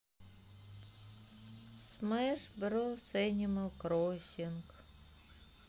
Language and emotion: Russian, sad